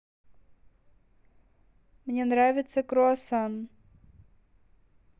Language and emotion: Russian, neutral